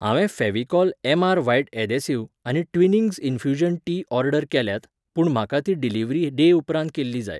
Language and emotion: Goan Konkani, neutral